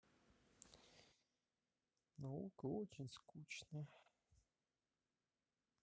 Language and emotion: Russian, sad